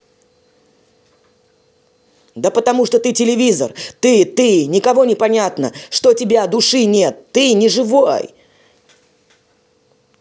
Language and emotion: Russian, angry